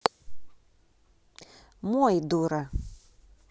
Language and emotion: Russian, neutral